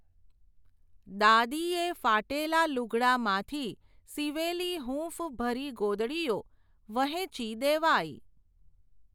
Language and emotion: Gujarati, neutral